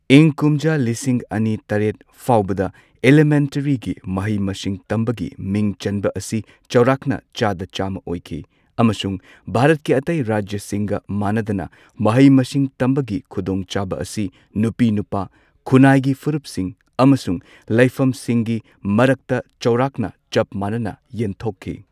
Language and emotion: Manipuri, neutral